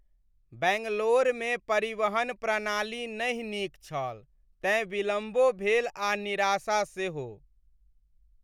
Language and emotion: Maithili, sad